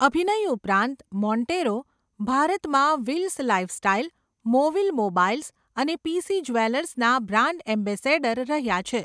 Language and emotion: Gujarati, neutral